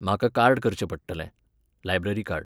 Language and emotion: Goan Konkani, neutral